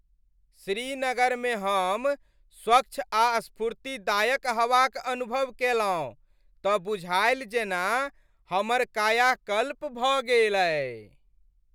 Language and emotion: Maithili, happy